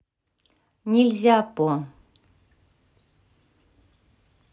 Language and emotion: Russian, neutral